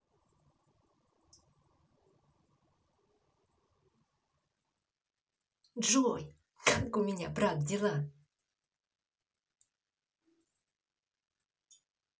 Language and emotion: Russian, positive